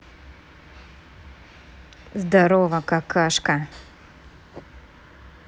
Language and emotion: Russian, angry